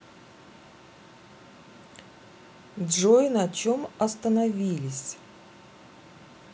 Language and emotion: Russian, neutral